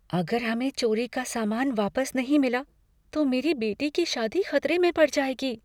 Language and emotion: Hindi, fearful